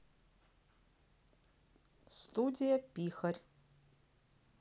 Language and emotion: Russian, neutral